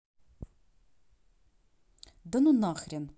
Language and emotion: Russian, angry